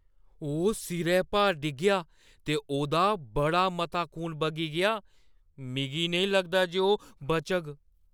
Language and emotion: Dogri, fearful